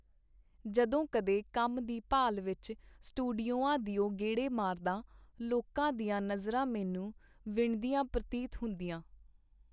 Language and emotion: Punjabi, neutral